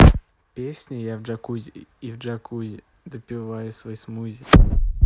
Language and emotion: Russian, positive